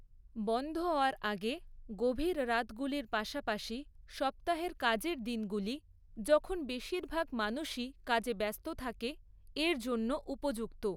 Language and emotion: Bengali, neutral